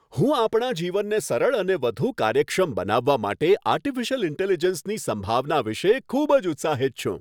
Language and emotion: Gujarati, happy